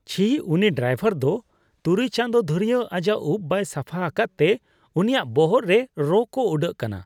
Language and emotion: Santali, disgusted